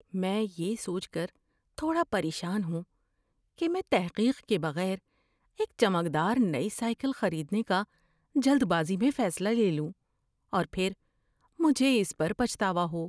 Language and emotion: Urdu, fearful